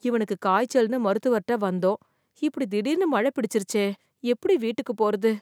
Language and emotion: Tamil, fearful